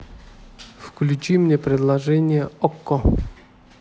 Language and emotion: Russian, neutral